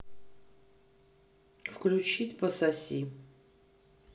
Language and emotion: Russian, neutral